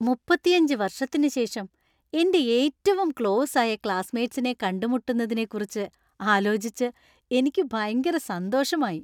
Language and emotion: Malayalam, happy